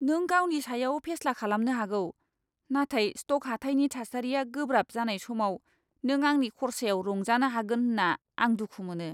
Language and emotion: Bodo, disgusted